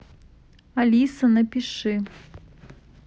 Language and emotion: Russian, neutral